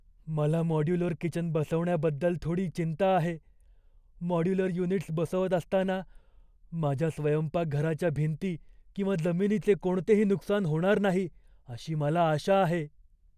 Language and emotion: Marathi, fearful